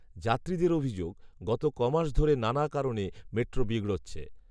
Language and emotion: Bengali, neutral